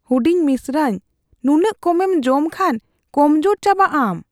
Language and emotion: Santali, fearful